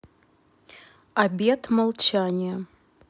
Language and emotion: Russian, neutral